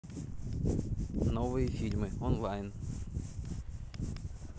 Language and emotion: Russian, neutral